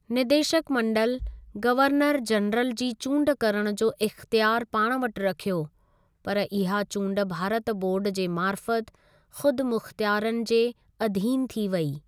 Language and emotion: Sindhi, neutral